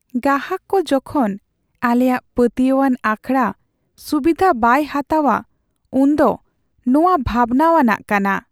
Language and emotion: Santali, sad